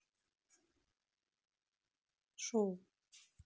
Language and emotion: Russian, neutral